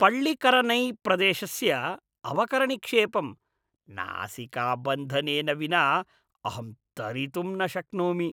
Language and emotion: Sanskrit, disgusted